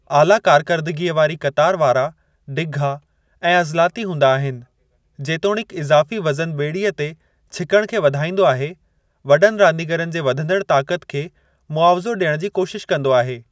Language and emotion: Sindhi, neutral